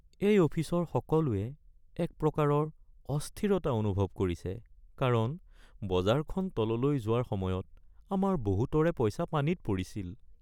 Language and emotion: Assamese, sad